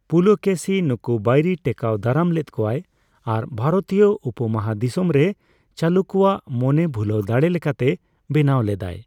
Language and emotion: Santali, neutral